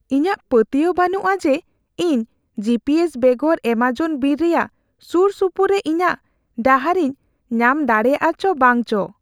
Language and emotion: Santali, fearful